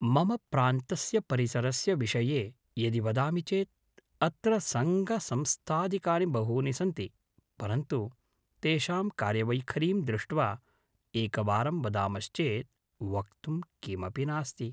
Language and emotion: Sanskrit, neutral